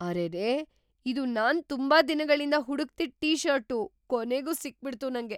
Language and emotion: Kannada, surprised